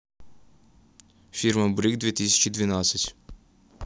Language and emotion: Russian, neutral